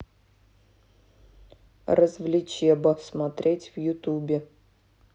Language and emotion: Russian, neutral